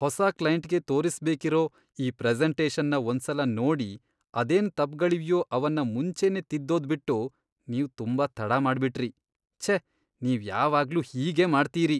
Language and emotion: Kannada, disgusted